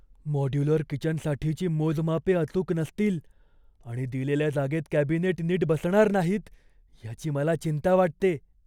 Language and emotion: Marathi, fearful